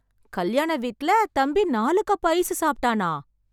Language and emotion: Tamil, surprised